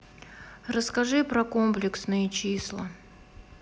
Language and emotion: Russian, sad